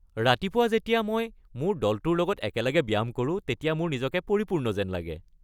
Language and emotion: Assamese, happy